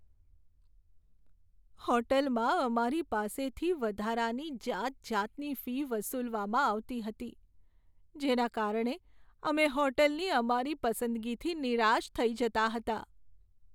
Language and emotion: Gujarati, sad